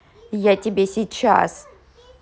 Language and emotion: Russian, angry